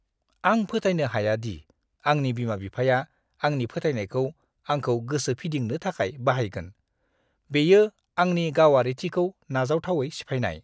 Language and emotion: Bodo, disgusted